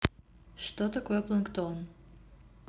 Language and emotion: Russian, neutral